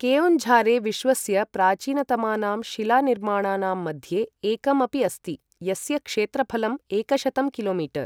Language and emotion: Sanskrit, neutral